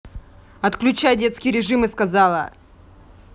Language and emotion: Russian, angry